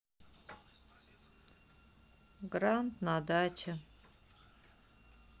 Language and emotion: Russian, sad